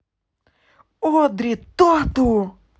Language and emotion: Russian, positive